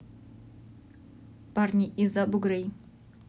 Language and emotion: Russian, neutral